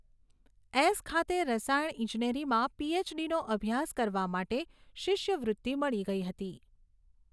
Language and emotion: Gujarati, neutral